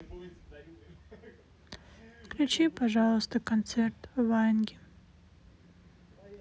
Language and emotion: Russian, sad